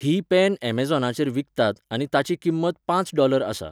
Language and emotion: Goan Konkani, neutral